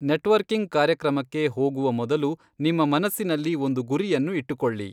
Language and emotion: Kannada, neutral